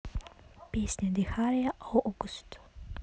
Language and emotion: Russian, neutral